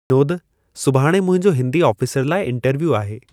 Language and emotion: Sindhi, neutral